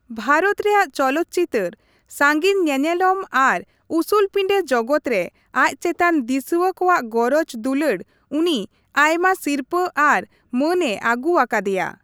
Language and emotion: Santali, neutral